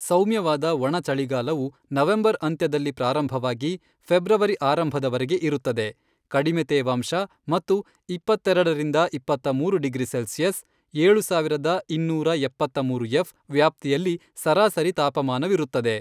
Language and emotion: Kannada, neutral